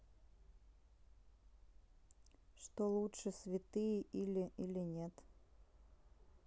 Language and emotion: Russian, neutral